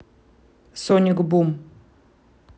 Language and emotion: Russian, neutral